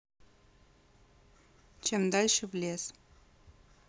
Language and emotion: Russian, neutral